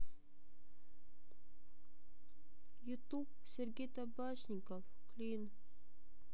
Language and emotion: Russian, sad